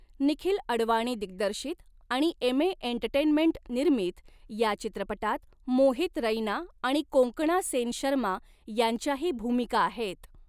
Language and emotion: Marathi, neutral